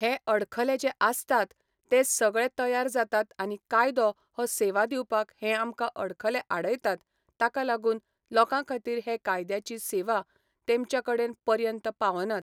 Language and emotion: Goan Konkani, neutral